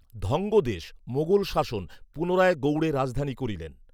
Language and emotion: Bengali, neutral